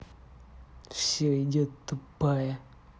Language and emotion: Russian, angry